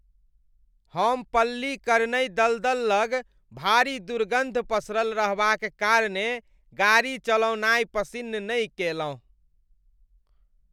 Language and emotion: Maithili, disgusted